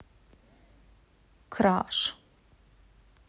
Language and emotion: Russian, neutral